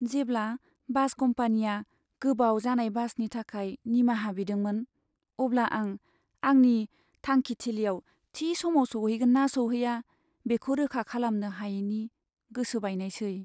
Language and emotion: Bodo, sad